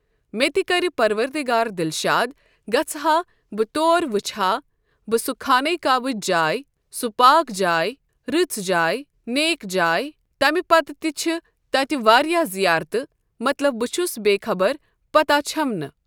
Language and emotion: Kashmiri, neutral